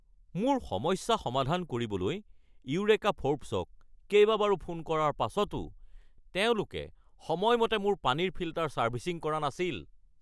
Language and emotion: Assamese, angry